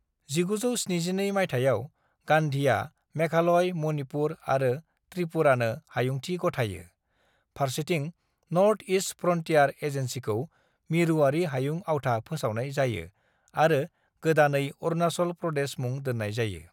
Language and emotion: Bodo, neutral